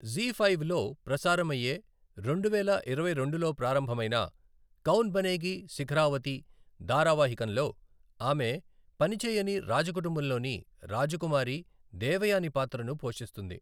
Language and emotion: Telugu, neutral